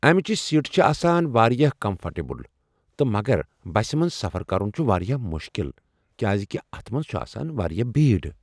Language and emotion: Kashmiri, neutral